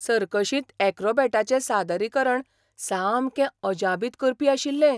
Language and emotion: Goan Konkani, surprised